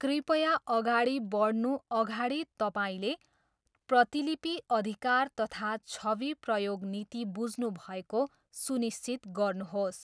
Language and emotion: Nepali, neutral